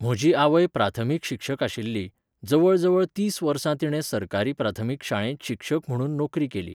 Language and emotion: Goan Konkani, neutral